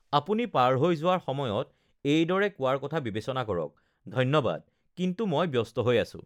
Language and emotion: Assamese, neutral